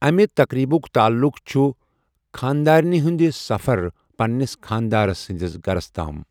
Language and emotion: Kashmiri, neutral